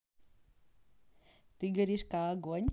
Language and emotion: Russian, positive